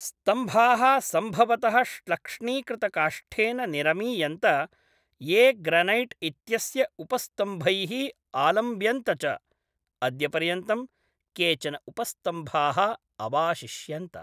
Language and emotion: Sanskrit, neutral